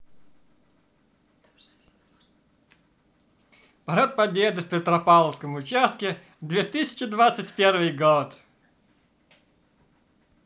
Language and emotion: Russian, positive